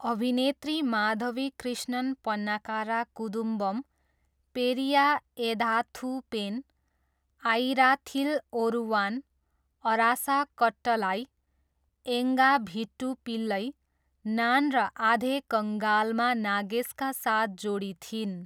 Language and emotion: Nepali, neutral